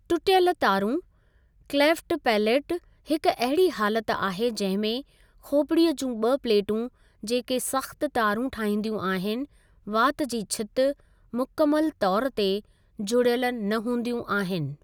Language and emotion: Sindhi, neutral